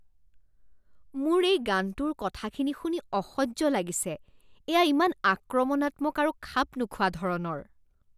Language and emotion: Assamese, disgusted